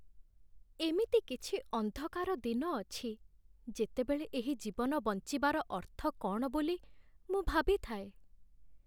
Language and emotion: Odia, sad